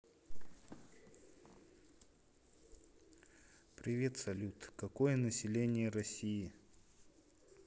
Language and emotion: Russian, neutral